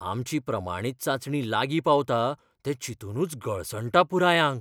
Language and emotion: Goan Konkani, fearful